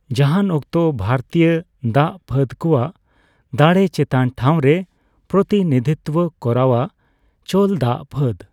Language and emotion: Santali, neutral